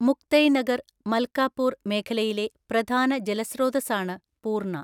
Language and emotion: Malayalam, neutral